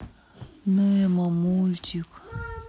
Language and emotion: Russian, sad